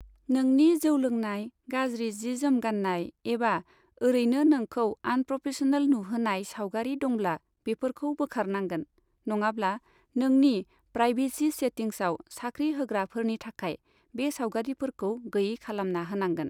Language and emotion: Bodo, neutral